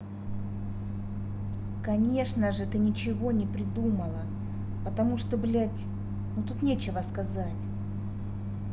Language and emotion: Russian, angry